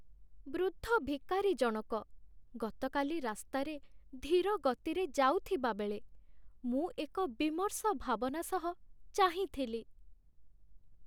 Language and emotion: Odia, sad